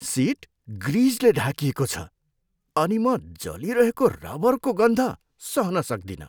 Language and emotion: Nepali, disgusted